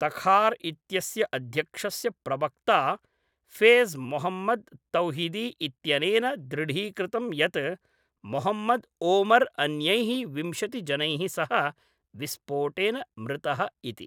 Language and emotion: Sanskrit, neutral